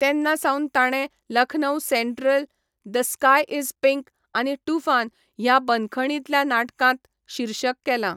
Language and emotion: Goan Konkani, neutral